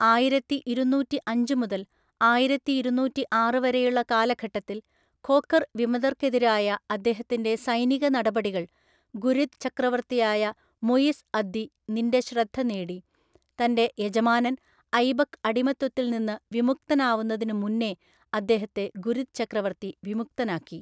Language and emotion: Malayalam, neutral